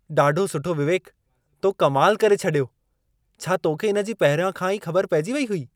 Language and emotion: Sindhi, surprised